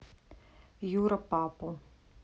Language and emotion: Russian, neutral